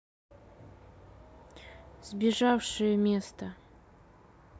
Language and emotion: Russian, neutral